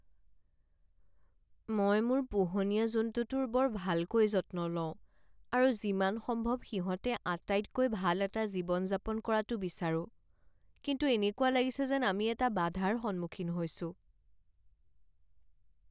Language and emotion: Assamese, sad